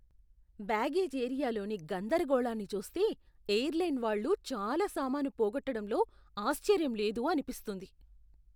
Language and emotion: Telugu, disgusted